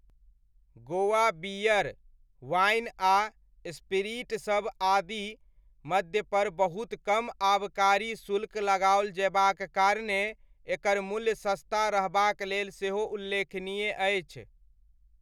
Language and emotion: Maithili, neutral